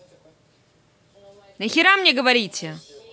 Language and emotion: Russian, angry